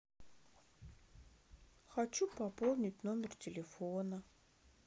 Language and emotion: Russian, sad